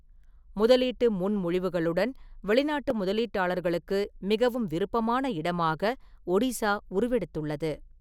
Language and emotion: Tamil, neutral